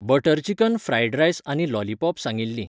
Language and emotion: Goan Konkani, neutral